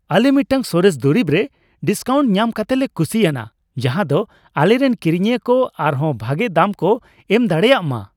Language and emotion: Santali, happy